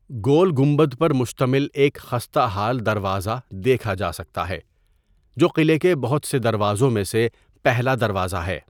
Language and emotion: Urdu, neutral